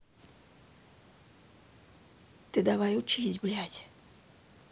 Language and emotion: Russian, neutral